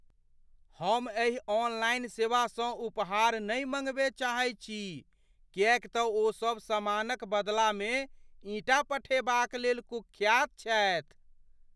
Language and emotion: Maithili, fearful